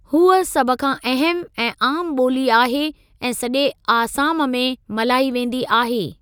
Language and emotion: Sindhi, neutral